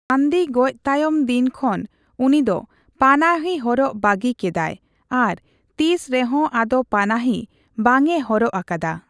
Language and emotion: Santali, neutral